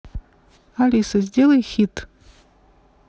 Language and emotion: Russian, neutral